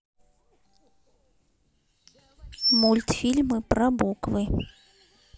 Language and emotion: Russian, neutral